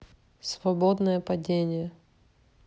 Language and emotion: Russian, neutral